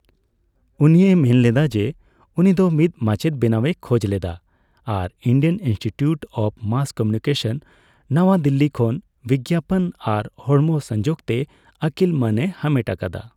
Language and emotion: Santali, neutral